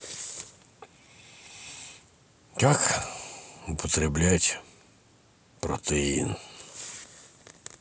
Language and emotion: Russian, sad